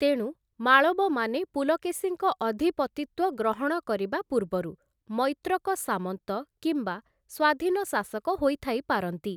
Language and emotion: Odia, neutral